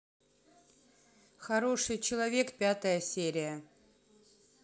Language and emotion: Russian, neutral